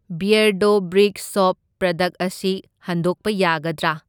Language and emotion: Manipuri, neutral